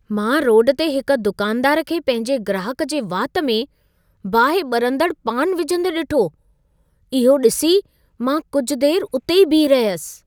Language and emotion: Sindhi, surprised